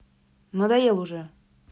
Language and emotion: Russian, angry